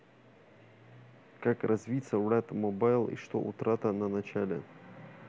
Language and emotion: Russian, neutral